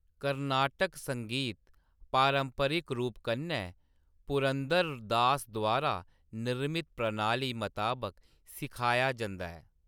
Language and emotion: Dogri, neutral